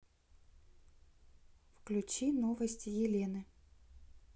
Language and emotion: Russian, neutral